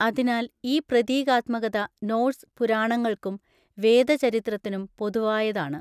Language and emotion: Malayalam, neutral